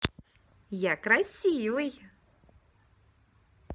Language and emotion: Russian, positive